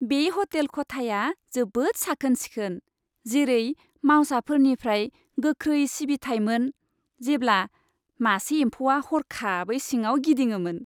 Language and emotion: Bodo, happy